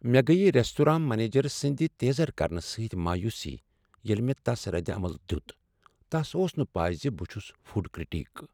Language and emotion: Kashmiri, sad